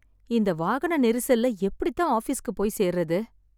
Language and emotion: Tamil, sad